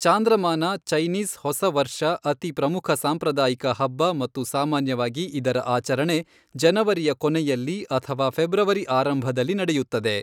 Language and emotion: Kannada, neutral